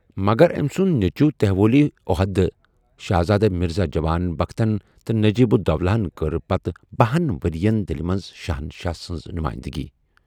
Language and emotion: Kashmiri, neutral